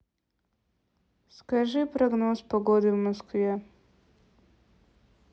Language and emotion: Russian, neutral